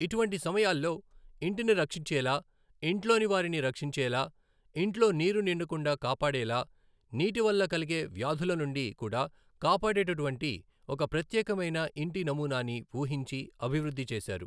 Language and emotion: Telugu, neutral